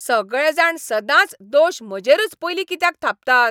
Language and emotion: Goan Konkani, angry